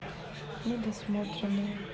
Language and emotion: Russian, neutral